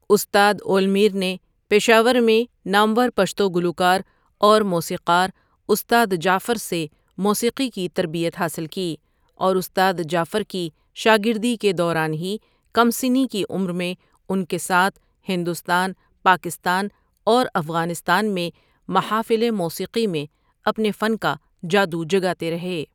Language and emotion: Urdu, neutral